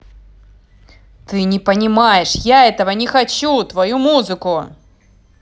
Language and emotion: Russian, angry